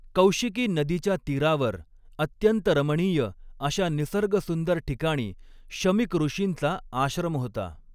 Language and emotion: Marathi, neutral